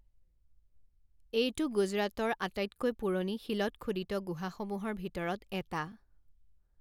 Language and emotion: Assamese, neutral